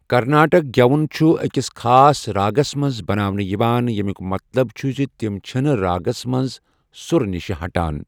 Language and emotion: Kashmiri, neutral